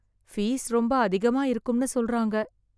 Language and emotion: Tamil, fearful